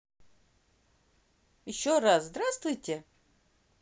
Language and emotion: Russian, positive